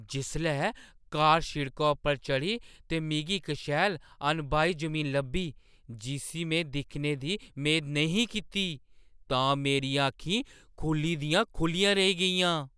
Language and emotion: Dogri, surprised